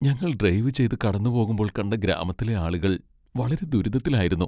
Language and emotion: Malayalam, sad